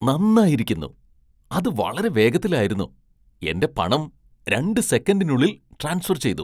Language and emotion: Malayalam, surprised